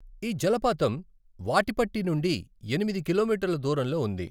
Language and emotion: Telugu, neutral